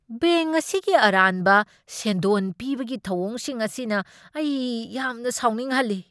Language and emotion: Manipuri, angry